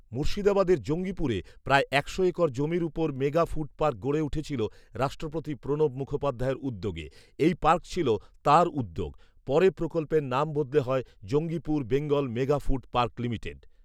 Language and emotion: Bengali, neutral